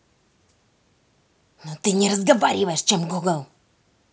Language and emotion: Russian, angry